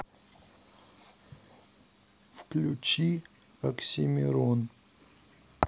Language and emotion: Russian, neutral